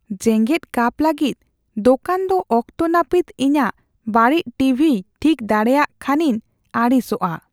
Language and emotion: Santali, fearful